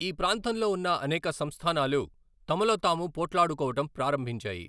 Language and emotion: Telugu, neutral